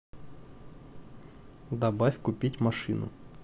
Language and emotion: Russian, neutral